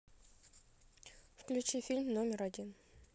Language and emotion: Russian, neutral